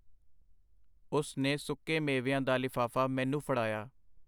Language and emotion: Punjabi, neutral